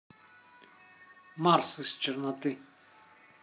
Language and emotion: Russian, neutral